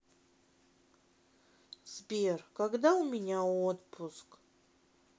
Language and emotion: Russian, sad